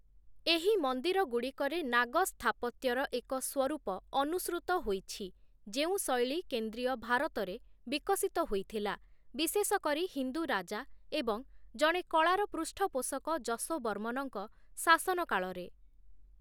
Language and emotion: Odia, neutral